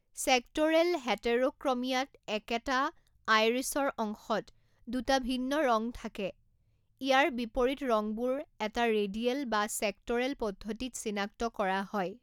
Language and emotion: Assamese, neutral